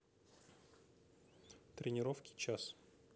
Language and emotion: Russian, neutral